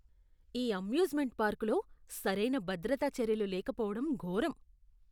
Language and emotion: Telugu, disgusted